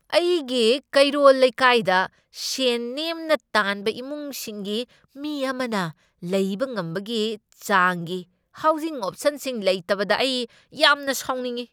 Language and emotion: Manipuri, angry